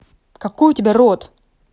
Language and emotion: Russian, angry